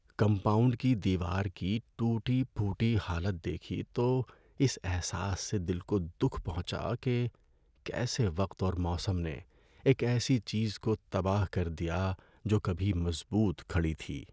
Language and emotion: Urdu, sad